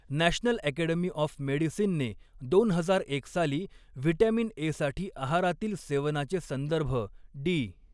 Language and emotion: Marathi, neutral